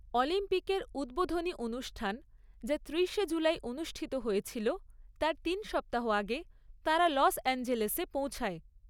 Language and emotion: Bengali, neutral